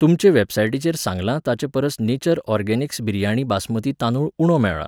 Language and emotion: Goan Konkani, neutral